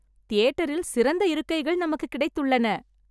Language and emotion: Tamil, happy